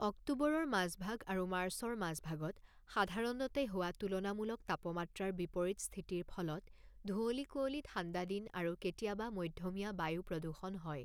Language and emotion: Assamese, neutral